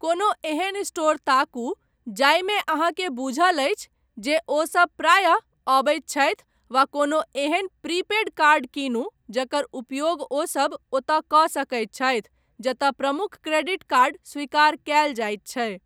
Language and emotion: Maithili, neutral